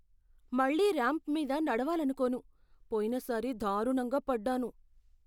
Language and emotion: Telugu, fearful